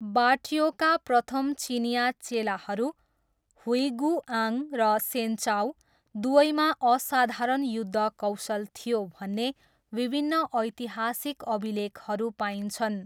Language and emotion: Nepali, neutral